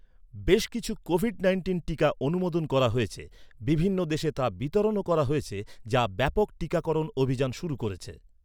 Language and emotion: Bengali, neutral